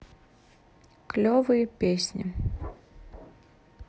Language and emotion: Russian, neutral